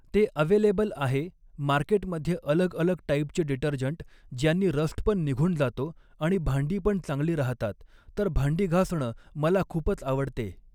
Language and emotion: Marathi, neutral